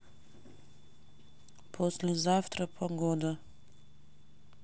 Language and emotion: Russian, neutral